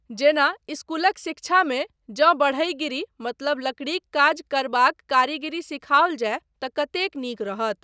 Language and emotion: Maithili, neutral